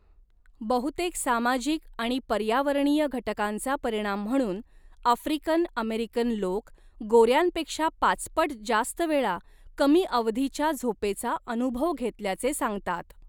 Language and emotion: Marathi, neutral